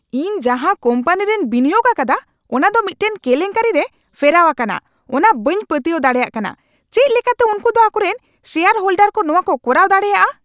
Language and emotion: Santali, angry